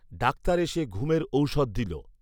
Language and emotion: Bengali, neutral